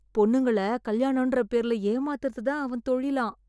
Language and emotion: Tamil, disgusted